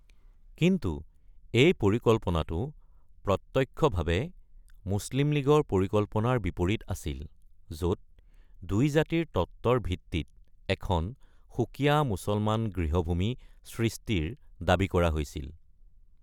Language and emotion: Assamese, neutral